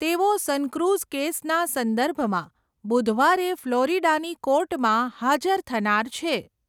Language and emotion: Gujarati, neutral